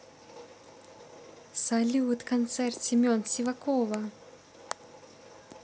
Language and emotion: Russian, positive